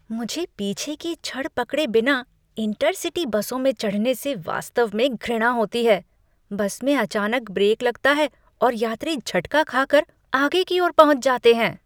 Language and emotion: Hindi, disgusted